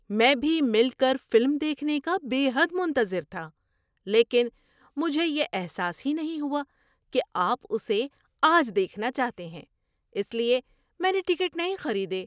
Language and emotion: Urdu, surprised